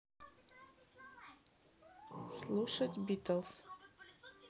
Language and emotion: Russian, neutral